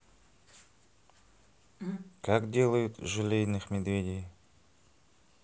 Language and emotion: Russian, neutral